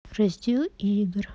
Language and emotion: Russian, neutral